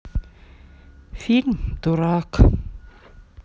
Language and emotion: Russian, sad